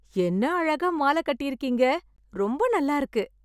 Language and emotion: Tamil, happy